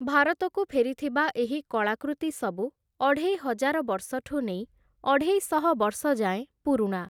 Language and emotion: Odia, neutral